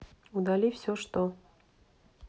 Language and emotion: Russian, neutral